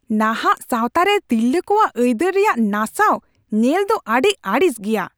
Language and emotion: Santali, angry